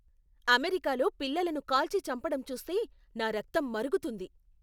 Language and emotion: Telugu, angry